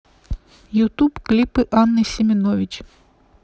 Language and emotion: Russian, neutral